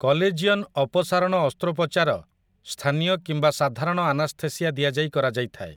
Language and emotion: Odia, neutral